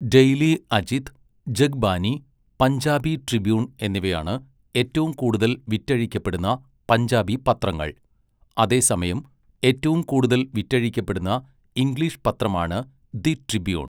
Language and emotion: Malayalam, neutral